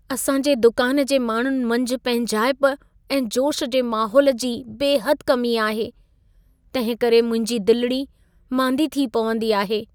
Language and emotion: Sindhi, sad